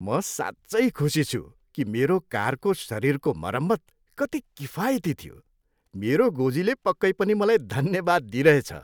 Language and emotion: Nepali, happy